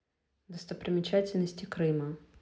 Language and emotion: Russian, neutral